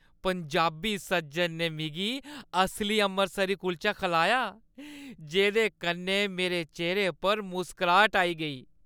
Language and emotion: Dogri, happy